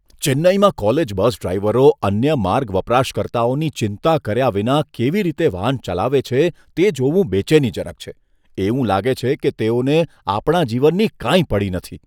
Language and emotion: Gujarati, disgusted